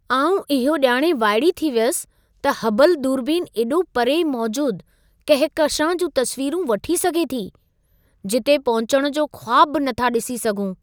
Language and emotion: Sindhi, surprised